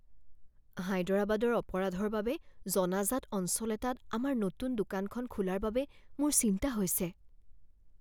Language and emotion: Assamese, fearful